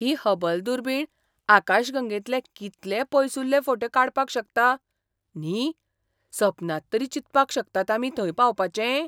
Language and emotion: Goan Konkani, surprised